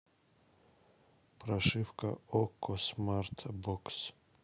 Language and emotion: Russian, neutral